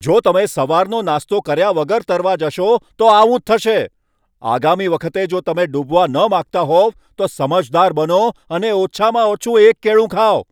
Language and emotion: Gujarati, angry